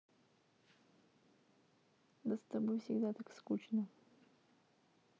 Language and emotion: Russian, sad